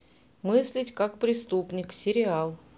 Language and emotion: Russian, neutral